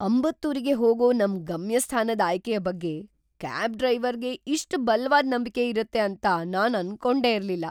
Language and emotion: Kannada, surprised